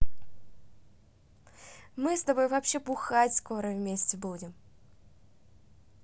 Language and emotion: Russian, positive